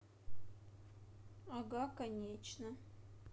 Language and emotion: Russian, neutral